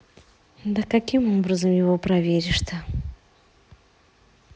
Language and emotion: Russian, neutral